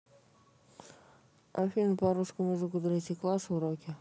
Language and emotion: Russian, neutral